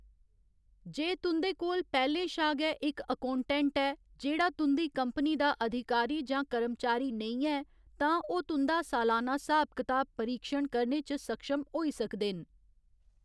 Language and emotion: Dogri, neutral